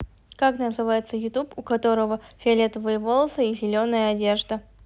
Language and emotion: Russian, neutral